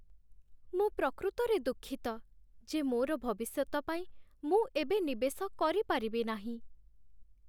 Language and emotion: Odia, sad